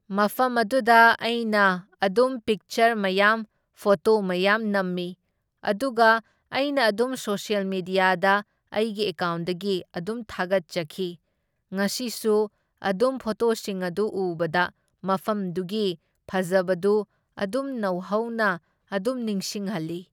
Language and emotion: Manipuri, neutral